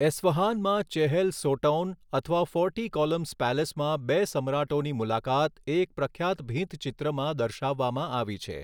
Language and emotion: Gujarati, neutral